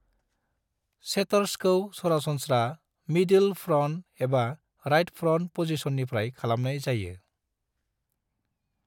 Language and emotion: Bodo, neutral